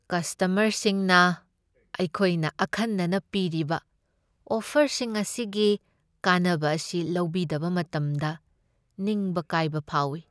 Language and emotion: Manipuri, sad